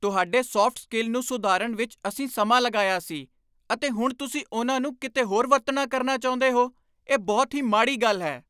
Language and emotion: Punjabi, angry